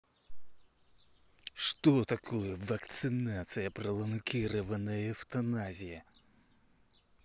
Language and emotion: Russian, angry